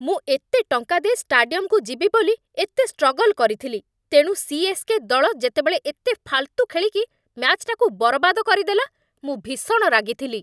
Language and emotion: Odia, angry